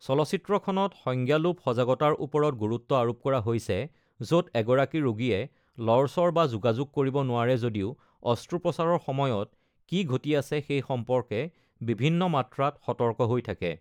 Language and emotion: Assamese, neutral